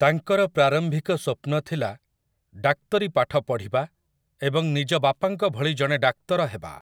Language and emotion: Odia, neutral